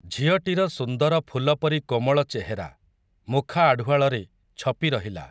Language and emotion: Odia, neutral